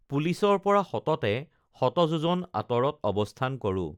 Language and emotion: Assamese, neutral